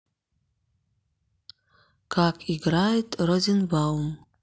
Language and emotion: Russian, neutral